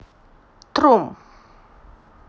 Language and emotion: Russian, neutral